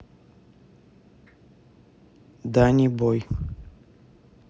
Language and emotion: Russian, neutral